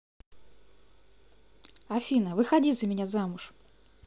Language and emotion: Russian, positive